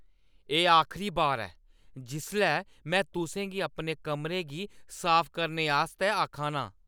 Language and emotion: Dogri, angry